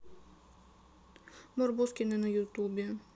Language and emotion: Russian, sad